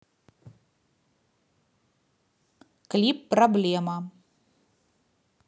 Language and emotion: Russian, neutral